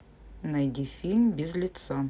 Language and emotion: Russian, neutral